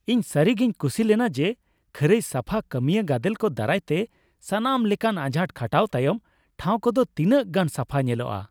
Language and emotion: Santali, happy